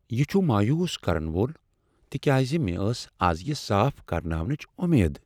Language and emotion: Kashmiri, sad